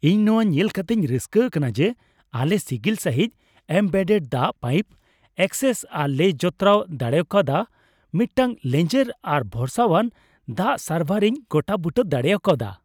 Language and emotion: Santali, happy